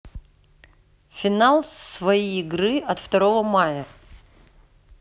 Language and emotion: Russian, neutral